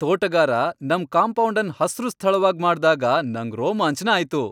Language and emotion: Kannada, happy